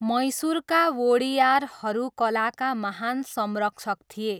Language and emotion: Nepali, neutral